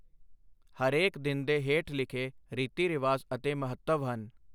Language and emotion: Punjabi, neutral